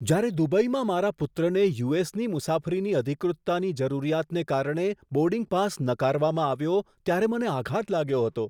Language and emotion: Gujarati, surprised